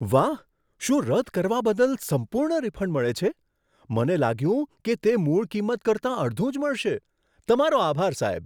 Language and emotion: Gujarati, surprised